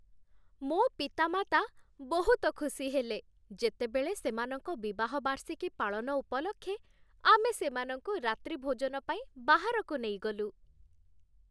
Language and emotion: Odia, happy